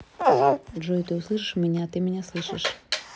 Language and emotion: Russian, neutral